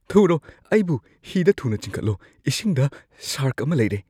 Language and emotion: Manipuri, fearful